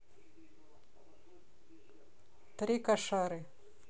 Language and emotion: Russian, neutral